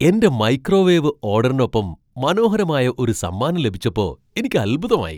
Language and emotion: Malayalam, surprised